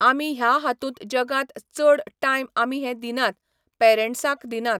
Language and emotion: Goan Konkani, neutral